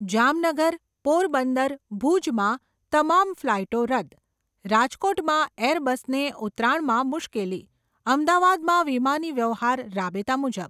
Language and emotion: Gujarati, neutral